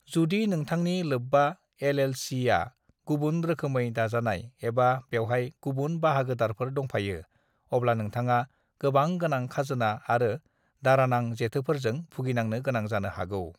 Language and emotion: Bodo, neutral